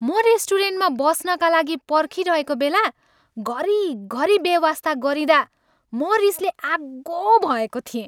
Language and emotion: Nepali, angry